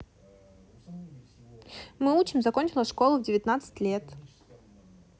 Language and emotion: Russian, neutral